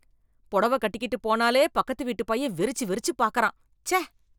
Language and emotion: Tamil, disgusted